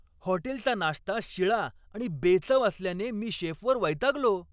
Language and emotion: Marathi, angry